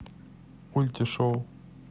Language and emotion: Russian, neutral